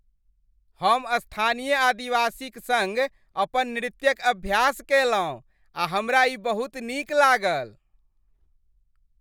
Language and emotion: Maithili, happy